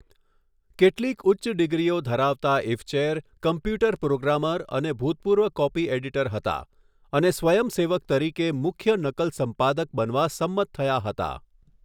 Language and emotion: Gujarati, neutral